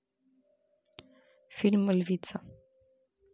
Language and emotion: Russian, neutral